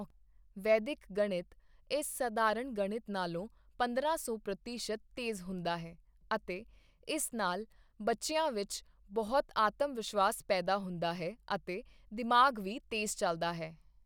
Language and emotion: Punjabi, neutral